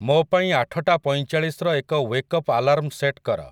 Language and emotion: Odia, neutral